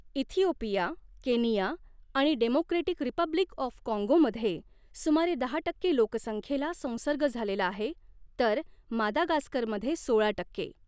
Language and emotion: Marathi, neutral